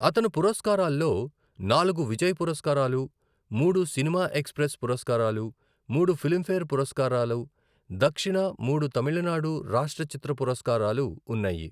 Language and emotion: Telugu, neutral